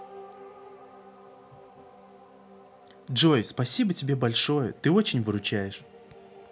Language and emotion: Russian, neutral